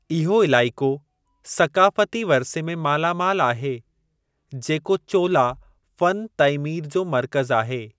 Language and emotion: Sindhi, neutral